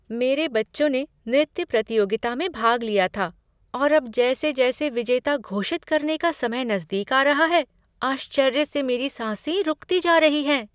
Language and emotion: Hindi, surprised